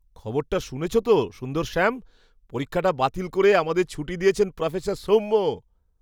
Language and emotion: Bengali, surprised